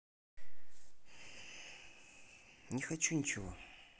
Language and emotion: Russian, sad